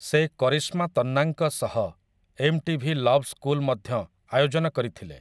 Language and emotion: Odia, neutral